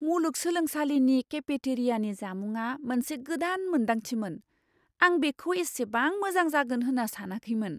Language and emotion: Bodo, surprised